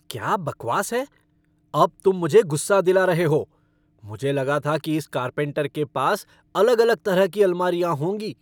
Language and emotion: Hindi, angry